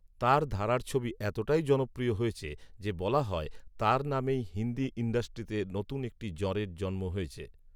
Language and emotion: Bengali, neutral